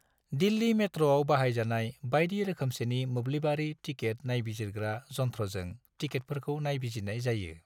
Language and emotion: Bodo, neutral